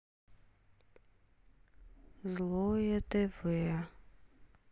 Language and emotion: Russian, sad